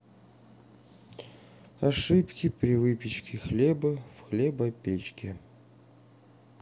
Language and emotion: Russian, sad